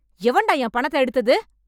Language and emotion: Tamil, angry